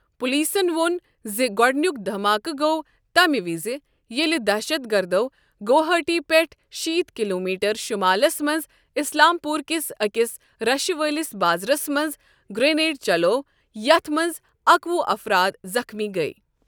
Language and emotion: Kashmiri, neutral